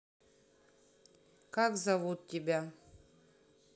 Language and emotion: Russian, neutral